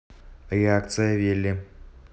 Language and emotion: Russian, neutral